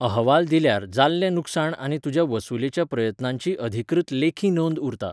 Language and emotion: Goan Konkani, neutral